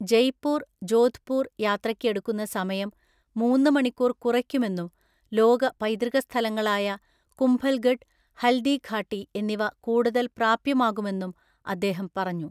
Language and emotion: Malayalam, neutral